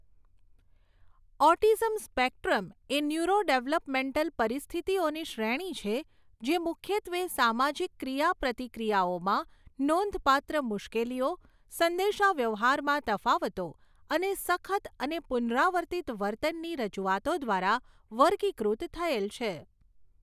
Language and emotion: Gujarati, neutral